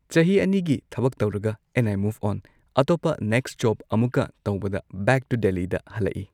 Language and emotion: Manipuri, neutral